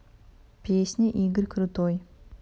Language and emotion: Russian, neutral